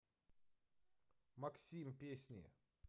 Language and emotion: Russian, neutral